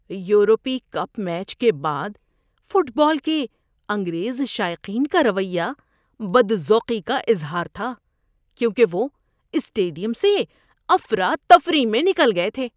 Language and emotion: Urdu, disgusted